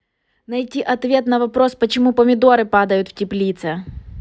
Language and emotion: Russian, angry